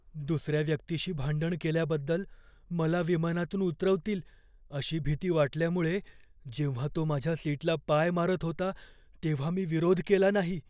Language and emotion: Marathi, fearful